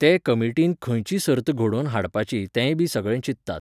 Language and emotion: Goan Konkani, neutral